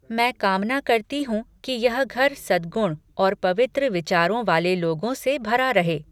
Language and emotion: Hindi, neutral